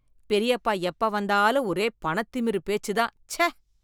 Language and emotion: Tamil, disgusted